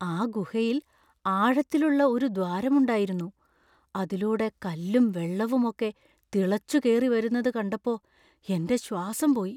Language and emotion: Malayalam, fearful